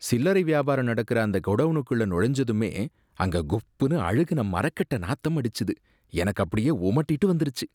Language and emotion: Tamil, disgusted